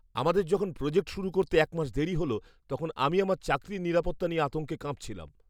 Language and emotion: Bengali, fearful